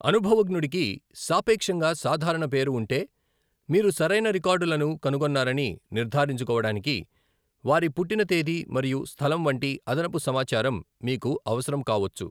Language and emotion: Telugu, neutral